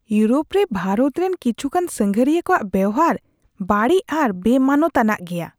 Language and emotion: Santali, disgusted